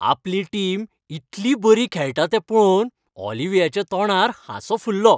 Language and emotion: Goan Konkani, happy